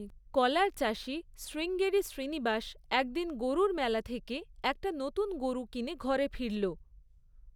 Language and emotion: Bengali, neutral